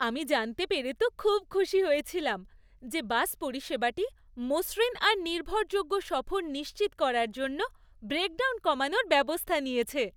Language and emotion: Bengali, happy